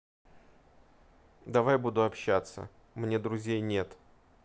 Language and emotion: Russian, neutral